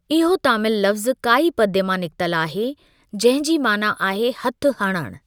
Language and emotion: Sindhi, neutral